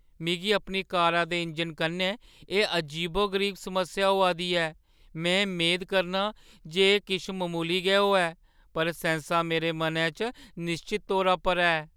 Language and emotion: Dogri, fearful